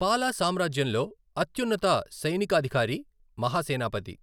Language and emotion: Telugu, neutral